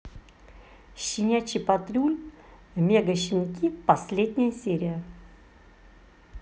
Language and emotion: Russian, neutral